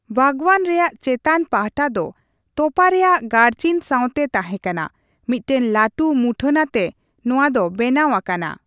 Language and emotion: Santali, neutral